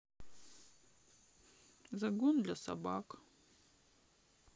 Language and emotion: Russian, sad